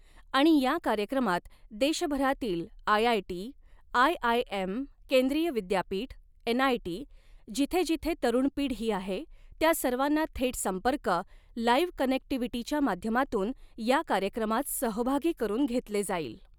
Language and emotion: Marathi, neutral